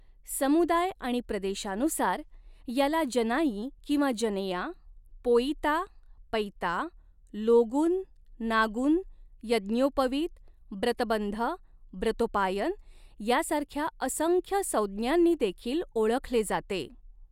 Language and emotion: Marathi, neutral